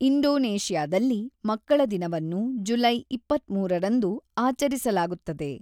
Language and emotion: Kannada, neutral